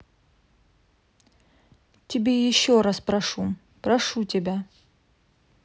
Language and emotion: Russian, neutral